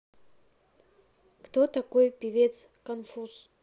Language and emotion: Russian, neutral